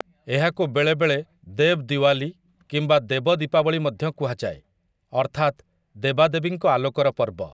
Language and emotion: Odia, neutral